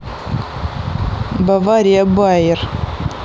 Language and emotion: Russian, neutral